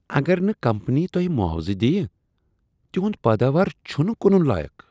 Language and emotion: Kashmiri, disgusted